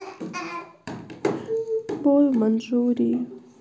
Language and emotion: Russian, sad